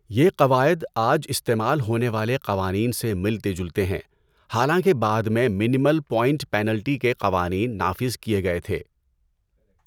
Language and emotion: Urdu, neutral